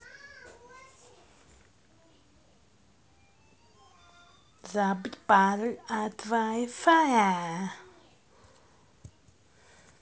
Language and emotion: Russian, positive